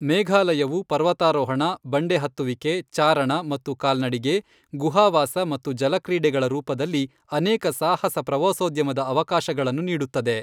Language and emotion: Kannada, neutral